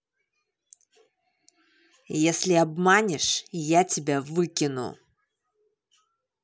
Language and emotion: Russian, angry